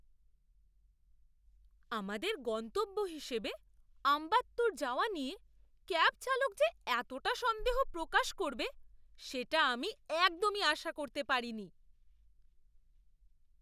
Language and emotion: Bengali, surprised